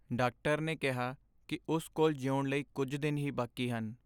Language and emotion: Punjabi, sad